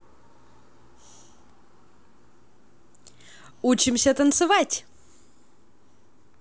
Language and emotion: Russian, positive